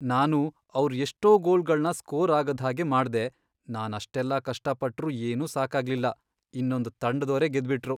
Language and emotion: Kannada, sad